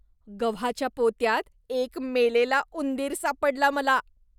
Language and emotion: Marathi, disgusted